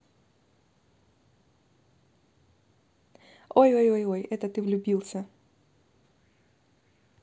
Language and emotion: Russian, positive